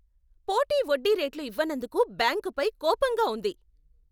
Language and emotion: Telugu, angry